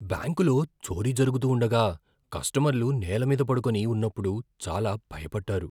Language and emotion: Telugu, fearful